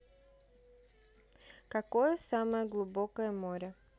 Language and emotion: Russian, neutral